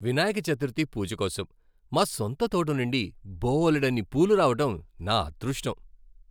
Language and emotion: Telugu, happy